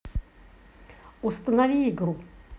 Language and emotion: Russian, neutral